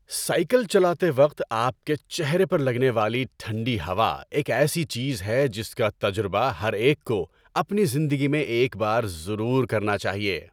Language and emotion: Urdu, happy